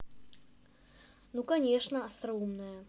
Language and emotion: Russian, angry